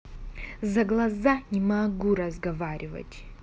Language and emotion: Russian, angry